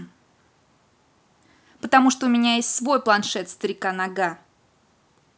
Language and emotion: Russian, angry